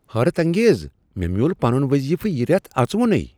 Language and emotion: Kashmiri, surprised